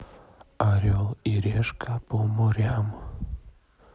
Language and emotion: Russian, neutral